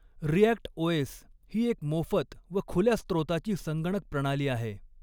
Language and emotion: Marathi, neutral